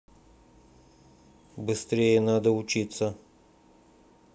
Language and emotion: Russian, neutral